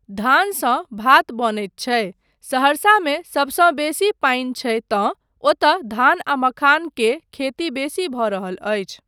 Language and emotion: Maithili, neutral